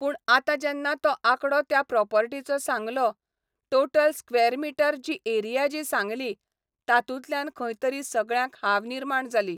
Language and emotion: Goan Konkani, neutral